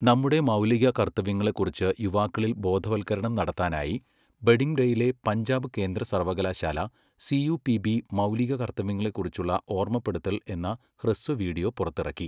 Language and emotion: Malayalam, neutral